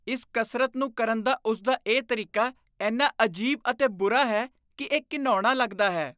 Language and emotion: Punjabi, disgusted